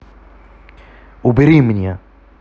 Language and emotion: Russian, angry